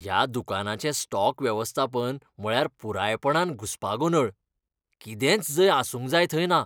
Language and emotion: Goan Konkani, disgusted